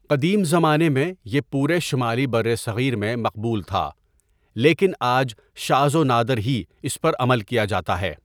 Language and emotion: Urdu, neutral